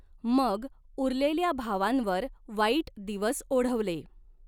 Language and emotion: Marathi, neutral